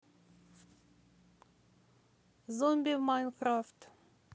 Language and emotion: Russian, positive